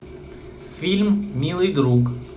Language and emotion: Russian, neutral